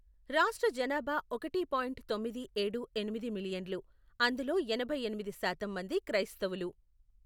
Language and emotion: Telugu, neutral